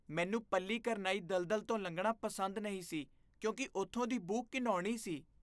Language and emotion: Punjabi, disgusted